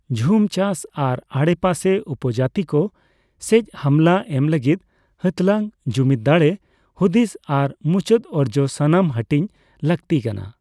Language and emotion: Santali, neutral